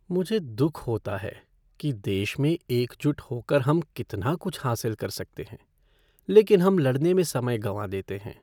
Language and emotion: Hindi, sad